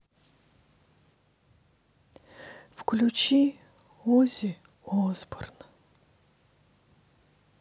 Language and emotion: Russian, sad